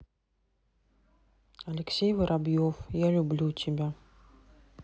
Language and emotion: Russian, neutral